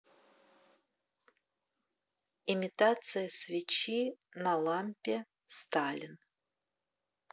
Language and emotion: Russian, neutral